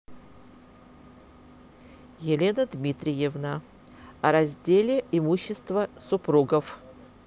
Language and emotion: Russian, neutral